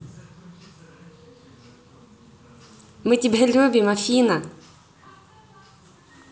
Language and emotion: Russian, positive